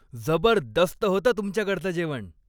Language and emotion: Marathi, happy